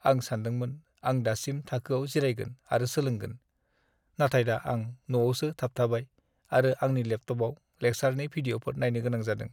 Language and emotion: Bodo, sad